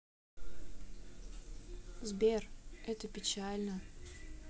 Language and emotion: Russian, sad